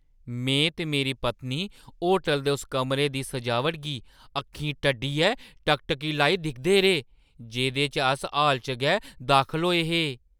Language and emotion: Dogri, surprised